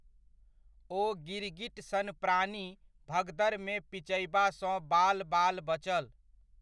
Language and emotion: Maithili, neutral